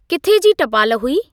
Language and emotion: Sindhi, neutral